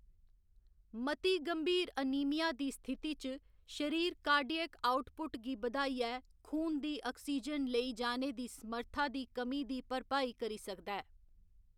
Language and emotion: Dogri, neutral